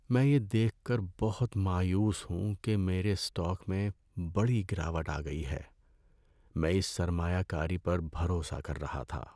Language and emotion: Urdu, sad